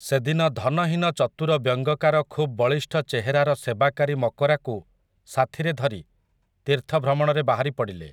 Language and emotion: Odia, neutral